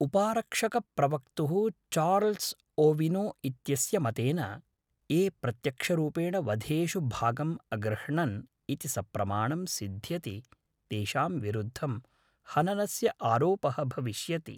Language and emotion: Sanskrit, neutral